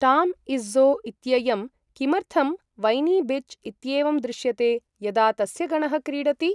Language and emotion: Sanskrit, neutral